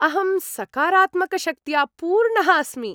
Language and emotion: Sanskrit, happy